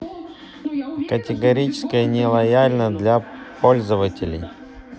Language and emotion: Russian, neutral